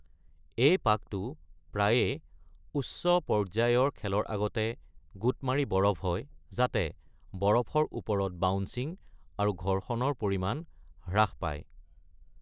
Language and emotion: Assamese, neutral